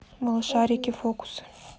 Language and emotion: Russian, neutral